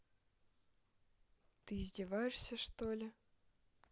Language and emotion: Russian, neutral